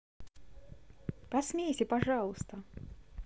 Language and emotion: Russian, positive